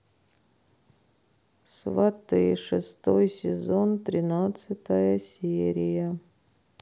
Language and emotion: Russian, sad